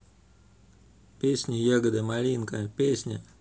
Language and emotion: Russian, neutral